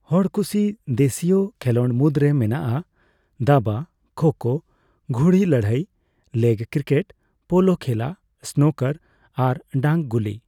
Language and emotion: Santali, neutral